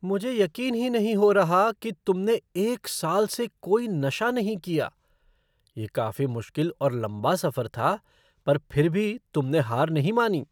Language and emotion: Hindi, surprised